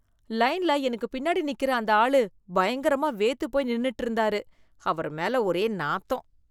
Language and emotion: Tamil, disgusted